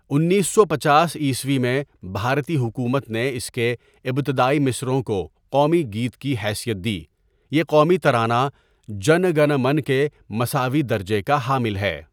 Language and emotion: Urdu, neutral